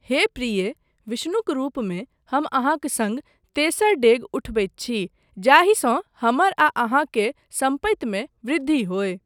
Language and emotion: Maithili, neutral